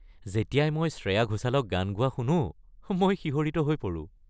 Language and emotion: Assamese, happy